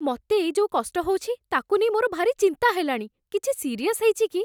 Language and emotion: Odia, fearful